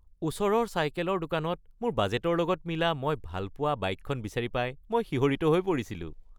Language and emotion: Assamese, happy